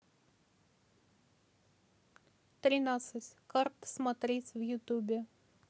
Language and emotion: Russian, neutral